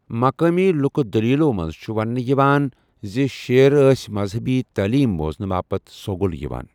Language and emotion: Kashmiri, neutral